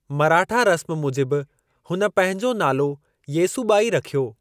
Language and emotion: Sindhi, neutral